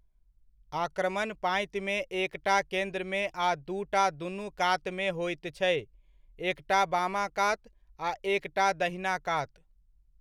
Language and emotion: Maithili, neutral